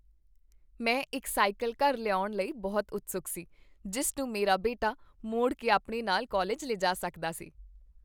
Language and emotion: Punjabi, happy